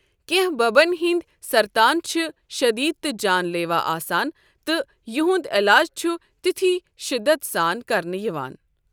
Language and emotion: Kashmiri, neutral